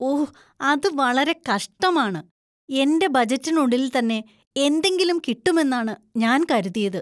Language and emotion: Malayalam, disgusted